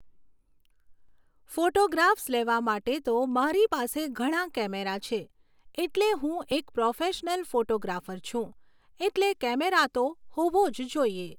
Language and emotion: Gujarati, neutral